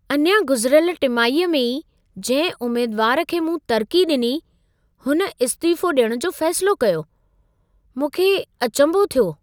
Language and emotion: Sindhi, surprised